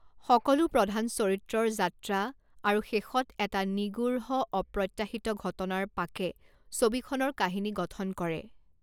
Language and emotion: Assamese, neutral